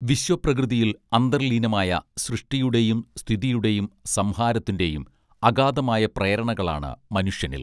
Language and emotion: Malayalam, neutral